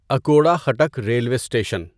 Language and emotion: Urdu, neutral